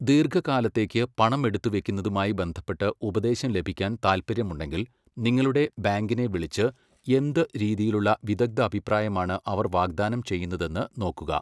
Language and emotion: Malayalam, neutral